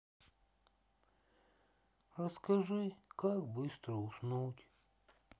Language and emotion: Russian, sad